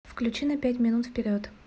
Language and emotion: Russian, neutral